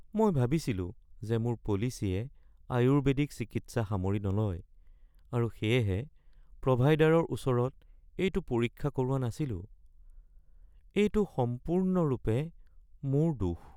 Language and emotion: Assamese, sad